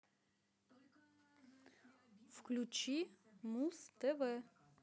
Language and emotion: Russian, positive